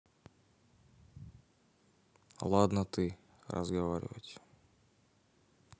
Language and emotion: Russian, neutral